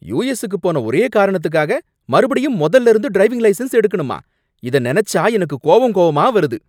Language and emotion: Tamil, angry